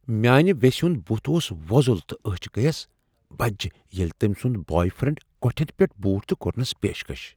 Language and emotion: Kashmiri, surprised